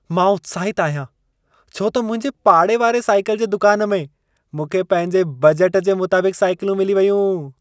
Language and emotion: Sindhi, happy